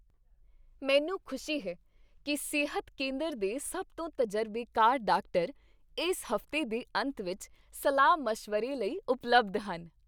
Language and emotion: Punjabi, happy